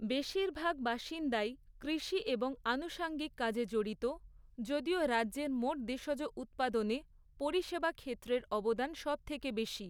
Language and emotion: Bengali, neutral